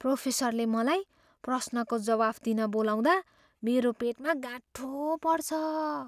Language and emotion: Nepali, fearful